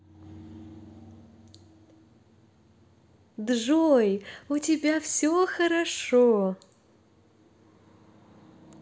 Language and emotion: Russian, positive